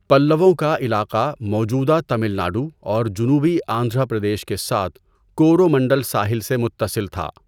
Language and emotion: Urdu, neutral